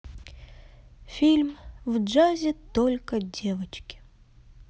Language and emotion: Russian, sad